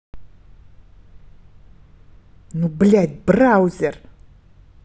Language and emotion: Russian, angry